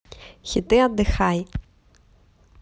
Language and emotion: Russian, positive